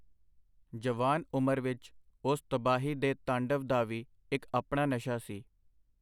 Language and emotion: Punjabi, neutral